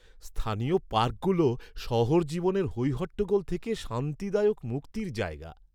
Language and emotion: Bengali, happy